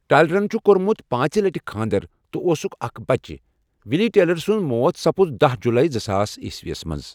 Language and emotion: Kashmiri, neutral